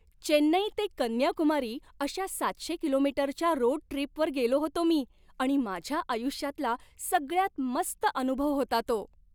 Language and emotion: Marathi, happy